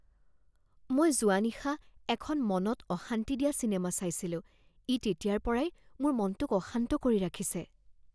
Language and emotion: Assamese, fearful